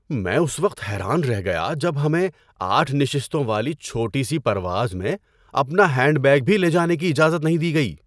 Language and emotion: Urdu, surprised